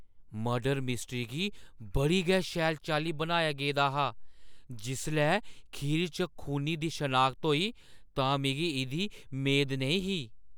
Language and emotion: Dogri, surprised